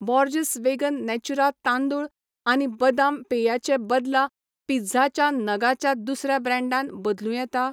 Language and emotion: Goan Konkani, neutral